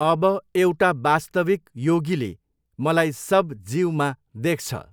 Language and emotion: Nepali, neutral